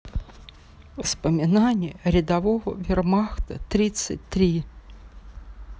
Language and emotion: Russian, sad